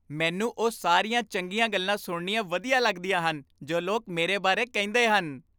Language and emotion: Punjabi, happy